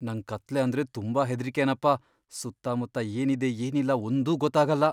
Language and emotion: Kannada, fearful